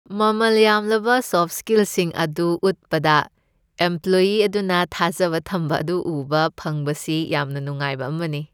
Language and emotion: Manipuri, happy